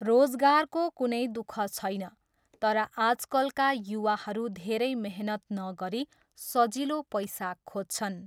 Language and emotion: Nepali, neutral